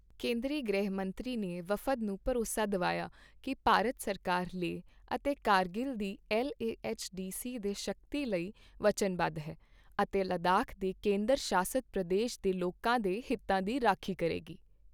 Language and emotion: Punjabi, neutral